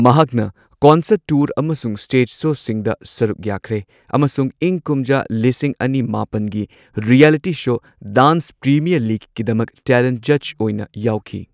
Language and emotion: Manipuri, neutral